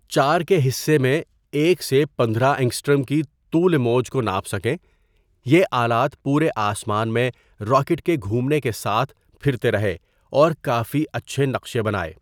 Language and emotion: Urdu, neutral